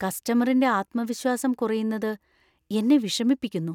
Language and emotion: Malayalam, fearful